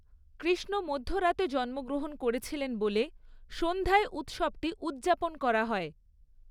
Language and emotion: Bengali, neutral